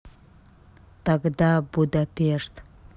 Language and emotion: Russian, neutral